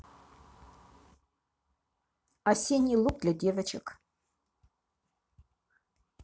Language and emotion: Russian, neutral